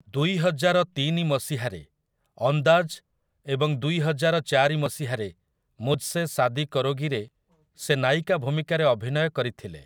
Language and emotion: Odia, neutral